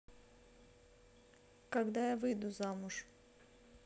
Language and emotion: Russian, neutral